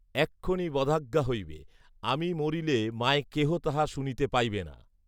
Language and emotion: Bengali, neutral